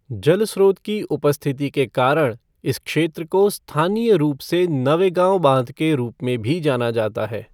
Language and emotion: Hindi, neutral